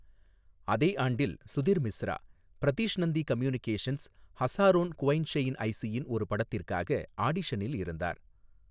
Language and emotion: Tamil, neutral